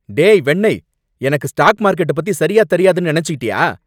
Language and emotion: Tamil, angry